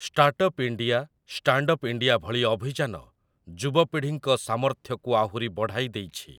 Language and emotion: Odia, neutral